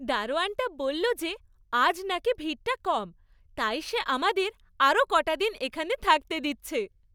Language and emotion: Bengali, happy